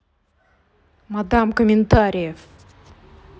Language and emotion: Russian, angry